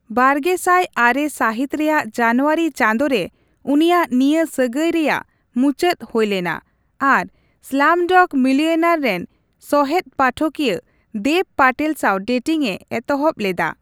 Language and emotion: Santali, neutral